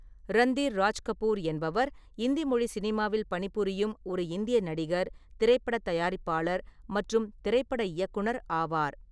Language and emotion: Tamil, neutral